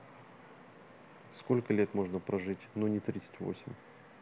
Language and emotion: Russian, neutral